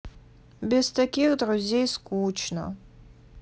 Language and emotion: Russian, sad